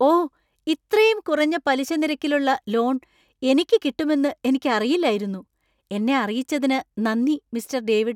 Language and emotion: Malayalam, surprised